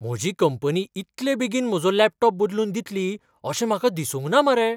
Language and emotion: Goan Konkani, surprised